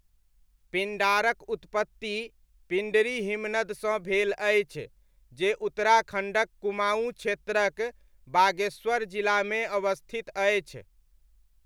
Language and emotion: Maithili, neutral